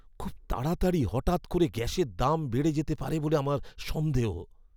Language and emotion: Bengali, fearful